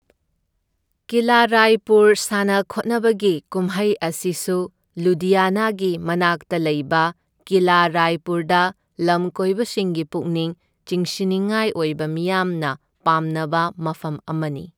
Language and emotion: Manipuri, neutral